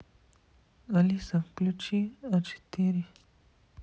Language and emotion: Russian, neutral